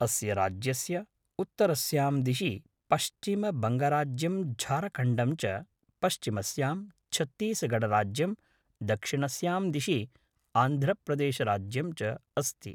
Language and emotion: Sanskrit, neutral